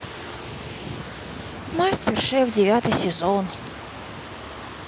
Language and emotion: Russian, sad